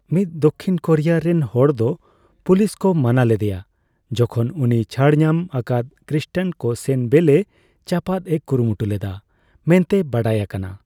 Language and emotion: Santali, neutral